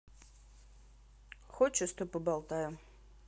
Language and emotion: Russian, neutral